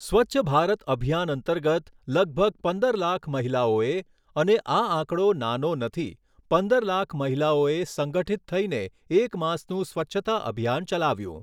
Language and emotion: Gujarati, neutral